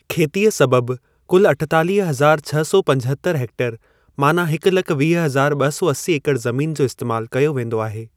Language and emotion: Sindhi, neutral